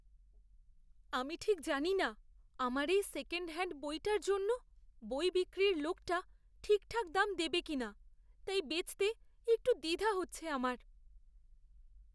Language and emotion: Bengali, fearful